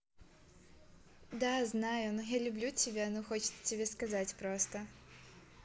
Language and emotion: Russian, positive